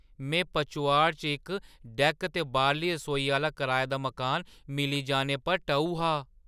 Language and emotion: Dogri, surprised